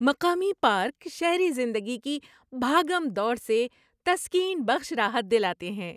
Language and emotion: Urdu, happy